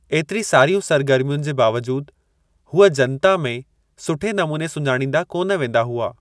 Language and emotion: Sindhi, neutral